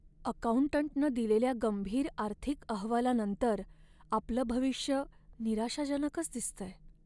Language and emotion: Marathi, sad